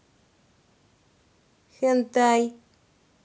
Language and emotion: Russian, neutral